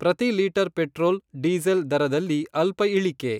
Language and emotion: Kannada, neutral